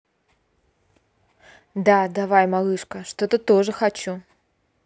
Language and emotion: Russian, positive